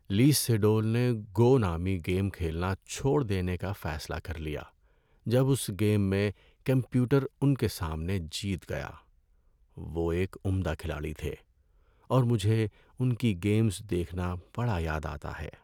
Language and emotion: Urdu, sad